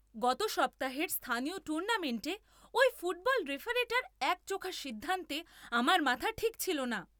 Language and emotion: Bengali, angry